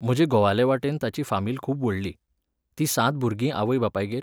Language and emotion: Goan Konkani, neutral